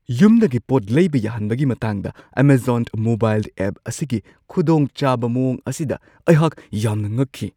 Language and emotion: Manipuri, surprised